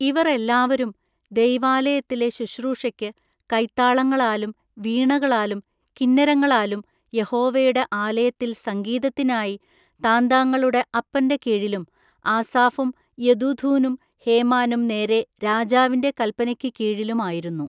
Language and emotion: Malayalam, neutral